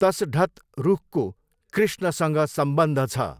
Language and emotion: Nepali, neutral